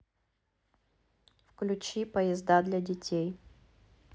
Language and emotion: Russian, neutral